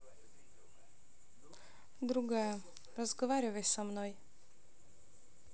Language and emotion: Russian, neutral